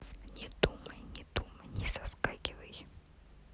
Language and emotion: Russian, neutral